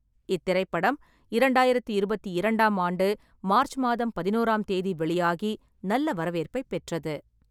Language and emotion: Tamil, neutral